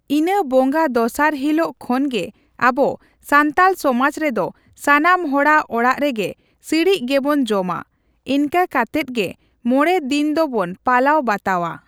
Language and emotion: Santali, neutral